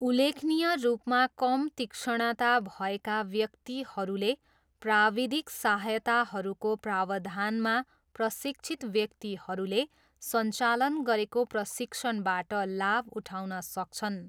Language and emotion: Nepali, neutral